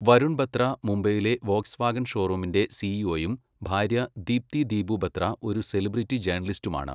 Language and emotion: Malayalam, neutral